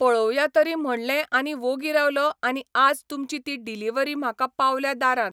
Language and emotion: Goan Konkani, neutral